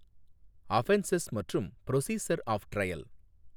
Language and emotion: Tamil, neutral